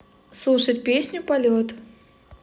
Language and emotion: Russian, neutral